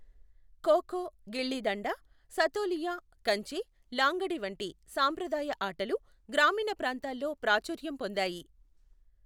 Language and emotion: Telugu, neutral